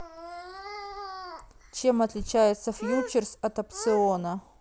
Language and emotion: Russian, neutral